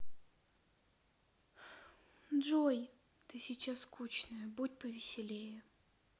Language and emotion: Russian, sad